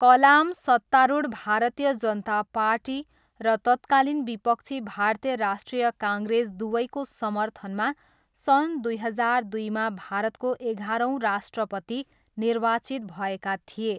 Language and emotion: Nepali, neutral